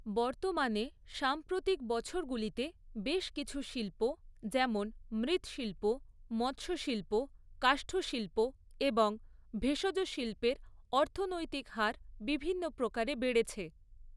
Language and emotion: Bengali, neutral